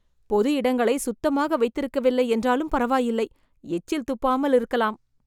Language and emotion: Tamil, disgusted